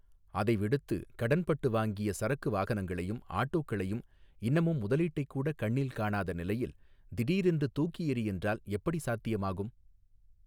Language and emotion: Tamil, neutral